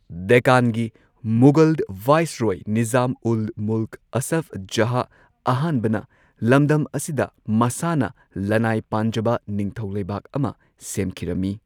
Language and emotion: Manipuri, neutral